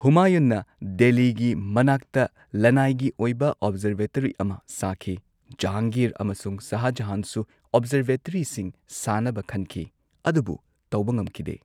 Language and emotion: Manipuri, neutral